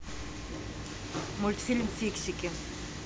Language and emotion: Russian, neutral